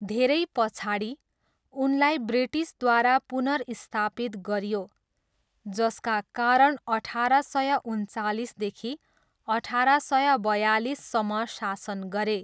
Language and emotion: Nepali, neutral